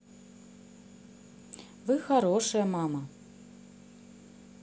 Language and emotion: Russian, positive